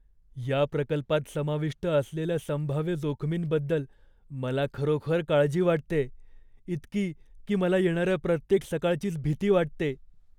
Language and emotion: Marathi, fearful